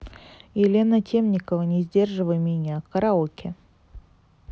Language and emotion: Russian, neutral